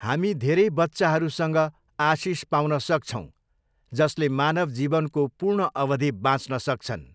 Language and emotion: Nepali, neutral